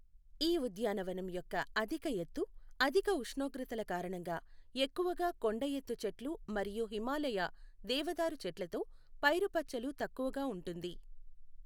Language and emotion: Telugu, neutral